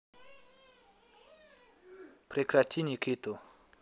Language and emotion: Russian, neutral